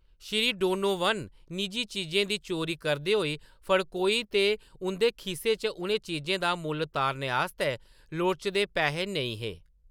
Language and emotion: Dogri, neutral